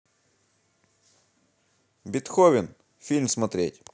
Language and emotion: Russian, positive